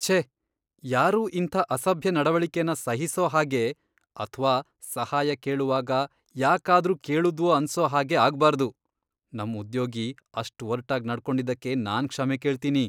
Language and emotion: Kannada, disgusted